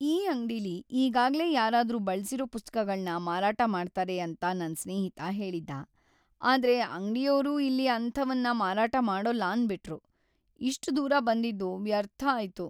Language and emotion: Kannada, sad